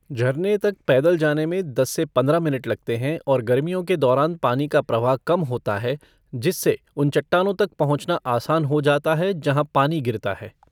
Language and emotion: Hindi, neutral